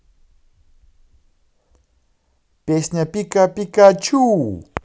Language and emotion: Russian, positive